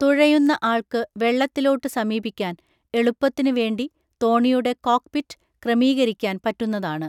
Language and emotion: Malayalam, neutral